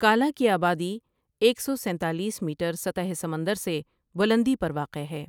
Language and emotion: Urdu, neutral